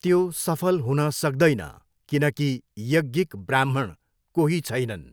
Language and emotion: Nepali, neutral